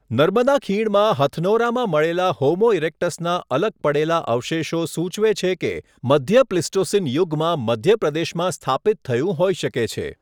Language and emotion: Gujarati, neutral